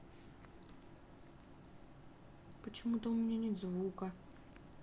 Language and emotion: Russian, sad